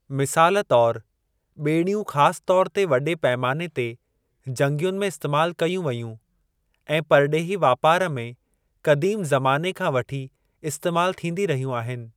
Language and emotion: Sindhi, neutral